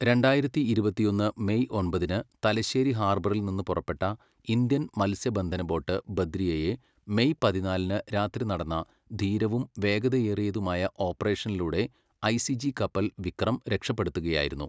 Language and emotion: Malayalam, neutral